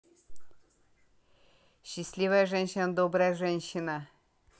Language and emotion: Russian, positive